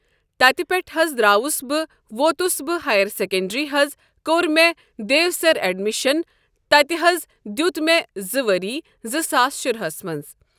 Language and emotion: Kashmiri, neutral